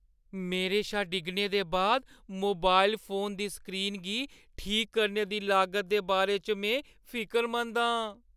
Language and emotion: Dogri, fearful